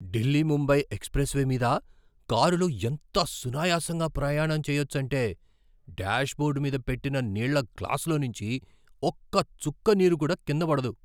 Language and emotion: Telugu, surprised